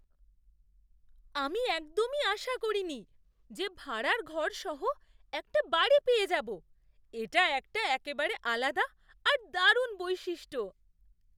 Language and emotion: Bengali, surprised